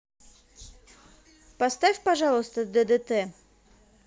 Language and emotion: Russian, positive